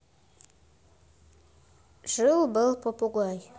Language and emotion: Russian, neutral